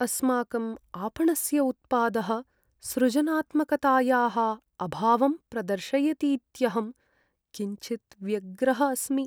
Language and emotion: Sanskrit, sad